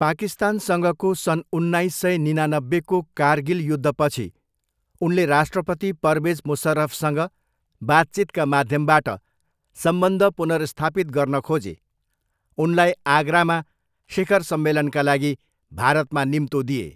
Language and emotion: Nepali, neutral